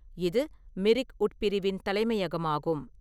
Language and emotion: Tamil, neutral